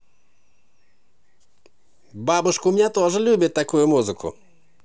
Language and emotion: Russian, positive